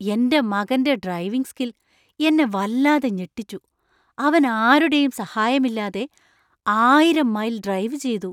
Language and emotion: Malayalam, surprised